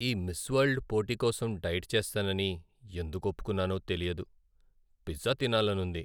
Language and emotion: Telugu, sad